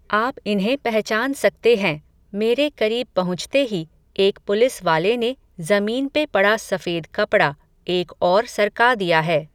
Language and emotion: Hindi, neutral